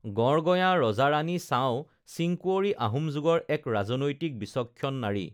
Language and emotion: Assamese, neutral